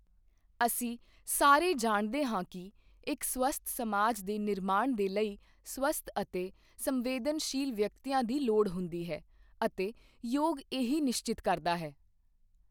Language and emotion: Punjabi, neutral